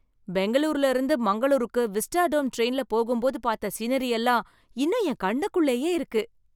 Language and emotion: Tamil, happy